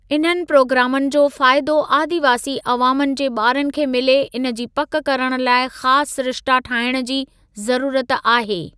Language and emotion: Sindhi, neutral